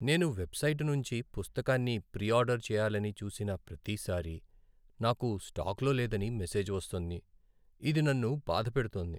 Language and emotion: Telugu, sad